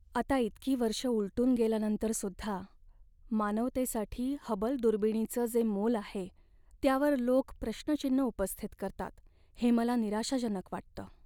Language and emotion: Marathi, sad